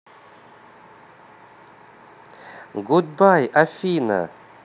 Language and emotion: Russian, positive